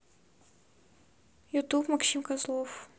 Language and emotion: Russian, neutral